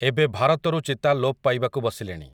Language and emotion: Odia, neutral